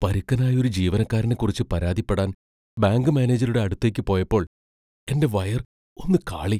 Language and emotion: Malayalam, fearful